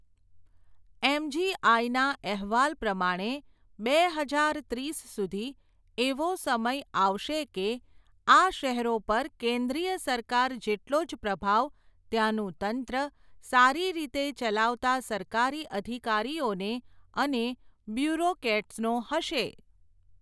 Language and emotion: Gujarati, neutral